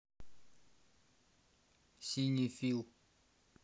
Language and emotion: Russian, neutral